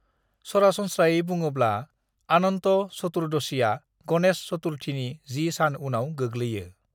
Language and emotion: Bodo, neutral